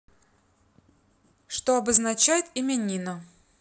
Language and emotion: Russian, neutral